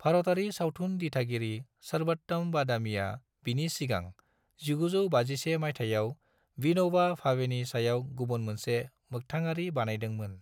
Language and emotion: Bodo, neutral